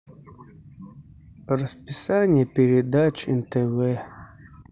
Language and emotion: Russian, neutral